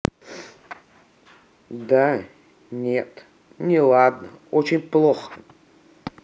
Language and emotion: Russian, sad